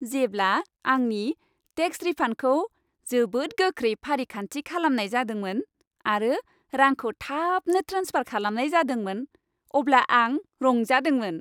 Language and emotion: Bodo, happy